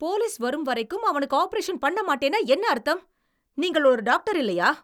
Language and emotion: Tamil, angry